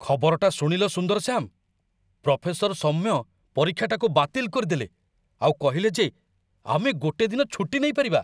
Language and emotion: Odia, surprised